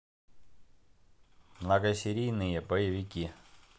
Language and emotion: Russian, neutral